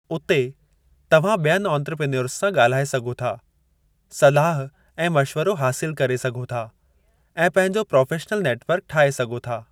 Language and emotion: Sindhi, neutral